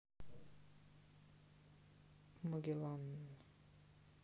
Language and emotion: Russian, neutral